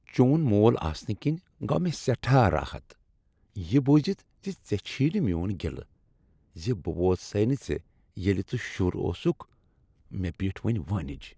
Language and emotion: Kashmiri, happy